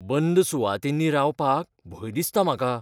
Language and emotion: Goan Konkani, fearful